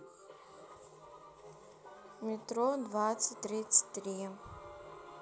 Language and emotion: Russian, neutral